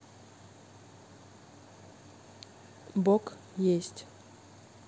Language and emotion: Russian, neutral